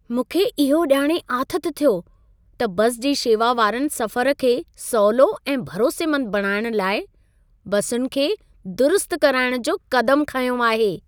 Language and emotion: Sindhi, happy